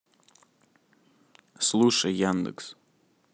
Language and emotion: Russian, neutral